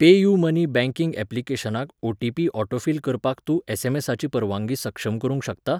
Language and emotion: Goan Konkani, neutral